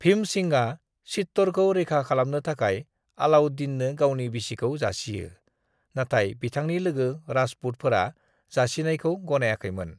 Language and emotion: Bodo, neutral